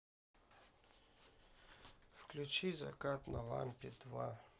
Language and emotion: Russian, sad